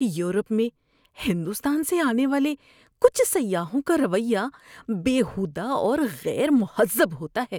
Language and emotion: Urdu, disgusted